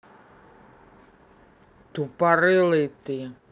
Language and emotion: Russian, angry